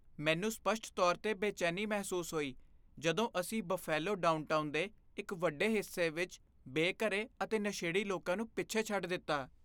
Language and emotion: Punjabi, fearful